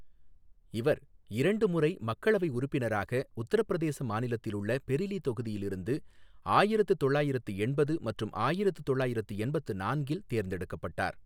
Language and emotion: Tamil, neutral